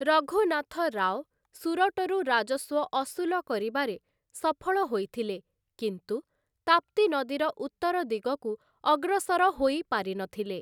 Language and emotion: Odia, neutral